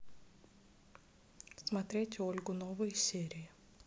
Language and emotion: Russian, neutral